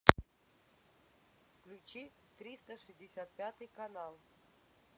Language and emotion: Russian, neutral